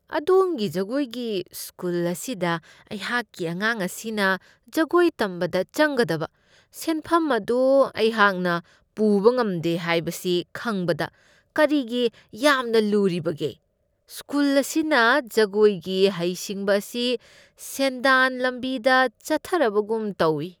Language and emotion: Manipuri, disgusted